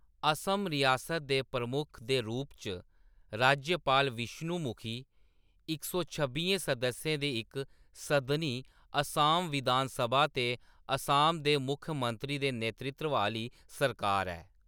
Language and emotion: Dogri, neutral